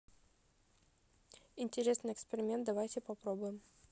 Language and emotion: Russian, neutral